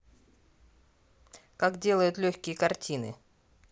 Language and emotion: Russian, neutral